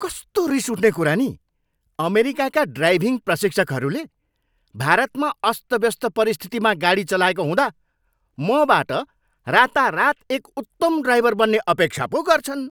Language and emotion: Nepali, angry